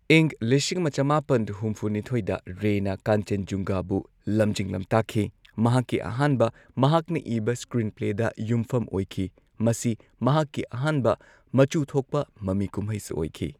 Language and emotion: Manipuri, neutral